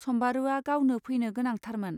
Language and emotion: Bodo, neutral